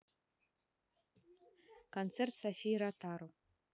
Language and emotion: Russian, neutral